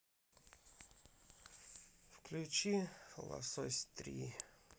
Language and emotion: Russian, sad